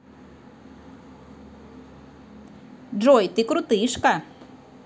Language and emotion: Russian, positive